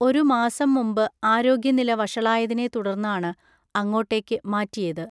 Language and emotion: Malayalam, neutral